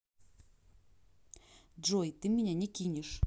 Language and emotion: Russian, neutral